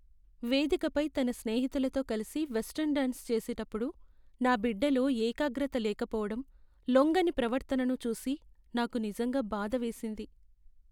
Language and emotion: Telugu, sad